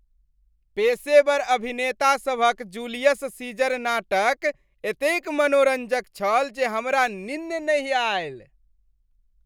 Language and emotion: Maithili, happy